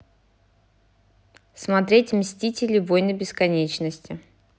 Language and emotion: Russian, neutral